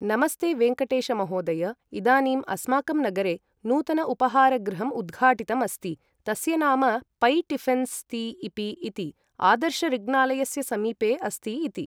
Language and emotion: Sanskrit, neutral